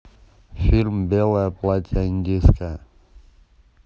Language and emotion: Russian, neutral